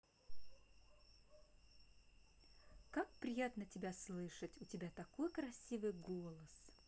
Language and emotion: Russian, positive